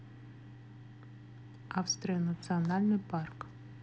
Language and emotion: Russian, neutral